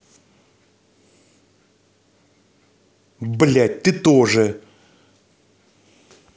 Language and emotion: Russian, angry